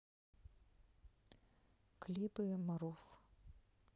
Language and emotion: Russian, sad